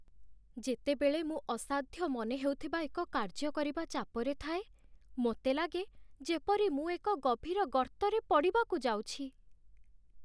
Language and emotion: Odia, sad